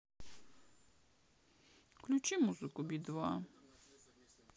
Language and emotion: Russian, sad